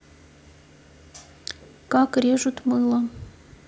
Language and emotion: Russian, neutral